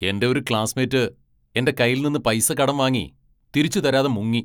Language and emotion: Malayalam, angry